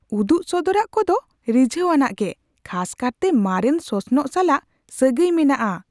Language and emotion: Santali, surprised